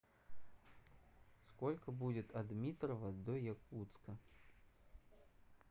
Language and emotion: Russian, neutral